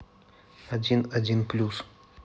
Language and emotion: Russian, neutral